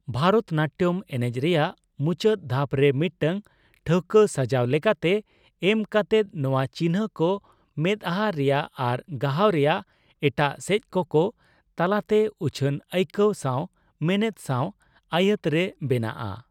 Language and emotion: Santali, neutral